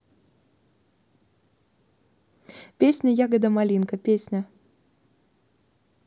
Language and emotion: Russian, neutral